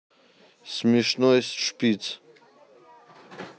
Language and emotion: Russian, neutral